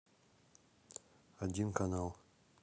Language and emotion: Russian, neutral